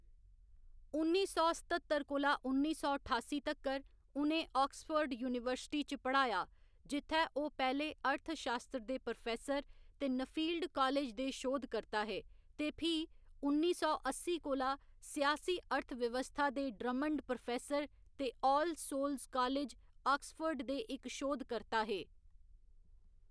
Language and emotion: Dogri, neutral